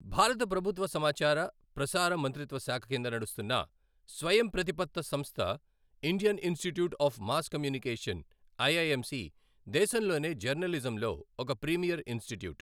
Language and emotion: Telugu, neutral